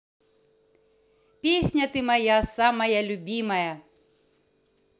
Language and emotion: Russian, positive